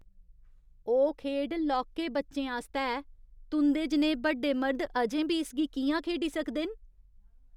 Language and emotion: Dogri, disgusted